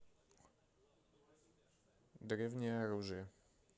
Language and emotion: Russian, neutral